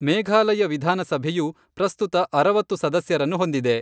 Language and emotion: Kannada, neutral